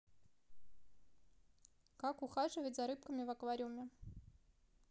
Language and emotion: Russian, neutral